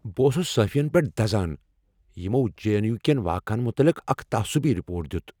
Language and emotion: Kashmiri, angry